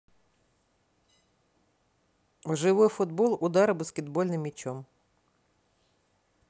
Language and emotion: Russian, neutral